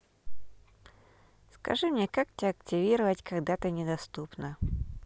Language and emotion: Russian, neutral